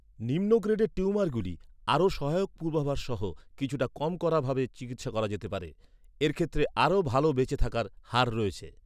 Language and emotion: Bengali, neutral